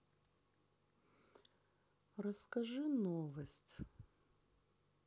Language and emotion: Russian, sad